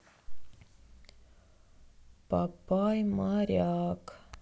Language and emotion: Russian, sad